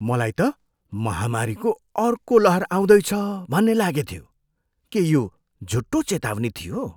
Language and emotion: Nepali, surprised